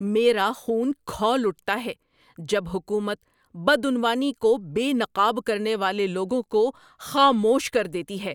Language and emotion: Urdu, angry